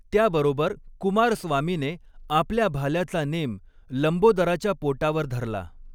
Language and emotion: Marathi, neutral